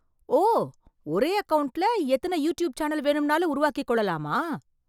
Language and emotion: Tamil, surprised